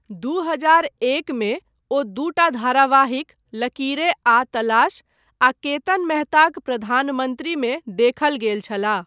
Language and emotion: Maithili, neutral